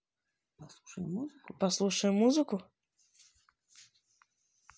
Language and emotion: Russian, positive